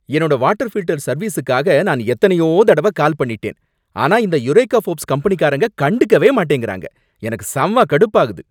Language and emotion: Tamil, angry